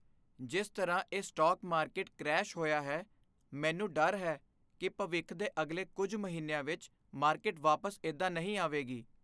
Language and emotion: Punjabi, fearful